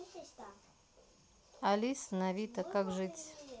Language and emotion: Russian, neutral